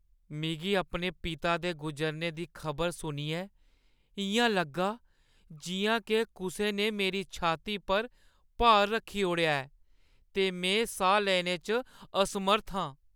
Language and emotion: Dogri, sad